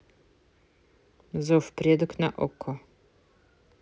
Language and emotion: Russian, neutral